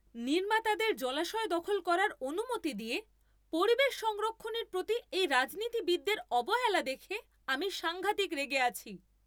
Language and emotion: Bengali, angry